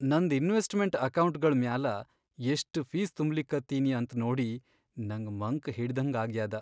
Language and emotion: Kannada, sad